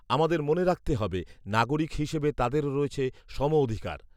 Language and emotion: Bengali, neutral